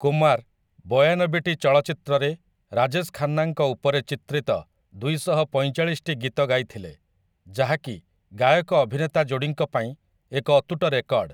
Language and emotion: Odia, neutral